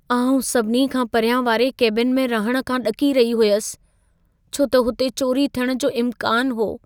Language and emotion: Sindhi, fearful